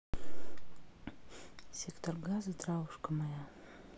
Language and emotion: Russian, neutral